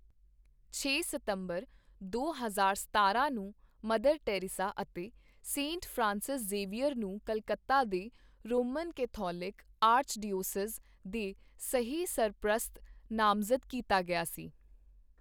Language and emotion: Punjabi, neutral